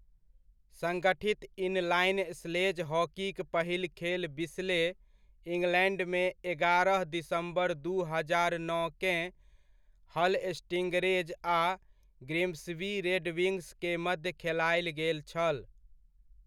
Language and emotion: Maithili, neutral